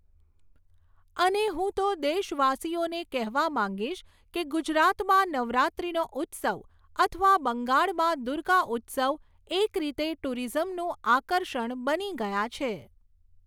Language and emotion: Gujarati, neutral